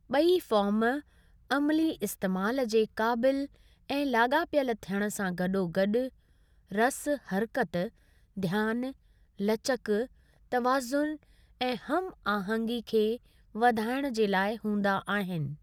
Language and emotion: Sindhi, neutral